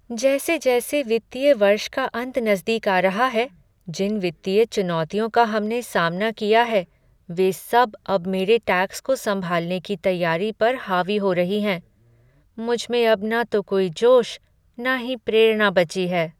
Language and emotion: Hindi, sad